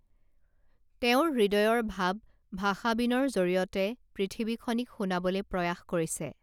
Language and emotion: Assamese, neutral